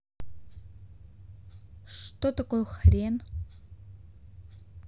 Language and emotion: Russian, neutral